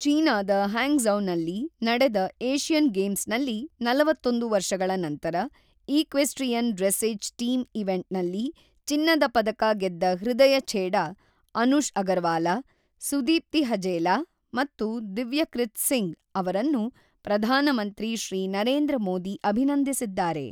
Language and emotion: Kannada, neutral